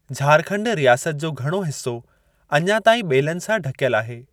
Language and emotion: Sindhi, neutral